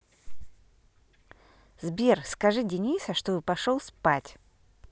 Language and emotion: Russian, positive